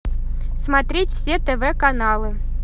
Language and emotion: Russian, positive